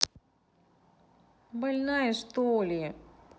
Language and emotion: Russian, neutral